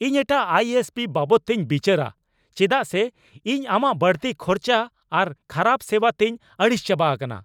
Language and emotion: Santali, angry